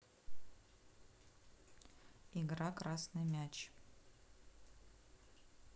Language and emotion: Russian, neutral